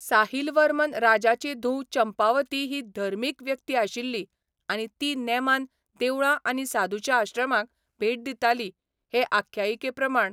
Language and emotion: Goan Konkani, neutral